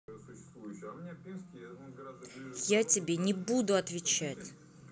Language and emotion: Russian, angry